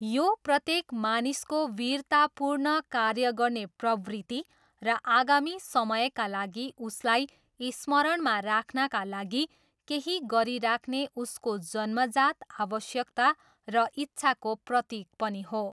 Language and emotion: Nepali, neutral